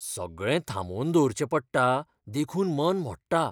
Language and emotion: Goan Konkani, fearful